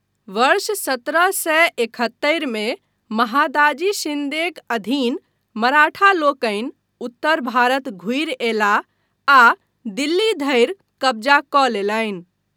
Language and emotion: Maithili, neutral